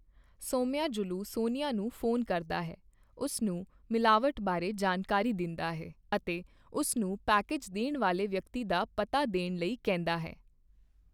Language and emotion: Punjabi, neutral